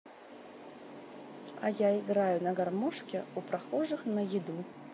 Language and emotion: Russian, neutral